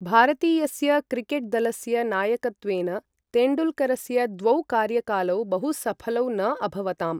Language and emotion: Sanskrit, neutral